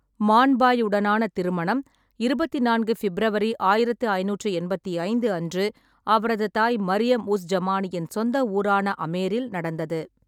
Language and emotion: Tamil, neutral